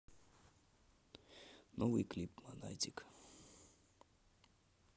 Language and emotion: Russian, neutral